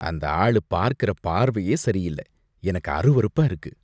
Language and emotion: Tamil, disgusted